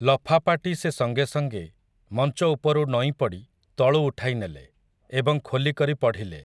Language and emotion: Odia, neutral